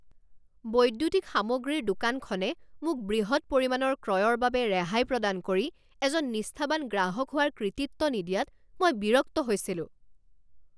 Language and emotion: Assamese, angry